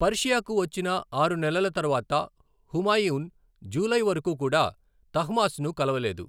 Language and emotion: Telugu, neutral